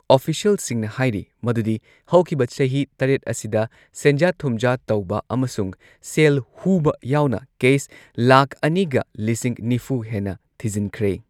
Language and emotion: Manipuri, neutral